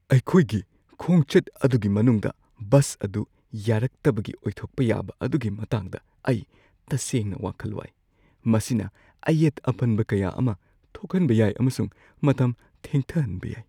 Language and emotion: Manipuri, fearful